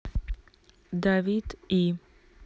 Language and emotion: Russian, neutral